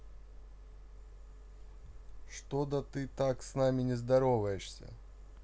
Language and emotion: Russian, neutral